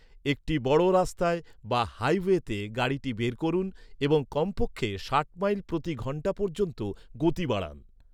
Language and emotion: Bengali, neutral